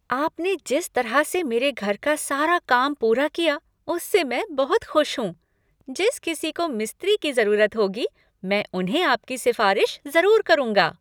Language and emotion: Hindi, happy